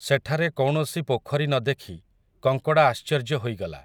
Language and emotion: Odia, neutral